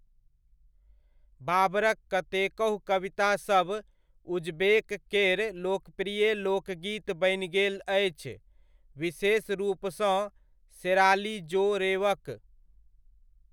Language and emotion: Maithili, neutral